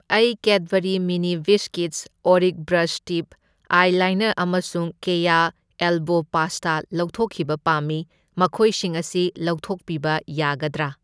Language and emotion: Manipuri, neutral